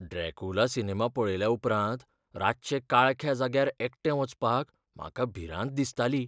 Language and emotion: Goan Konkani, fearful